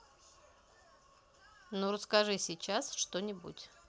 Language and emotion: Russian, neutral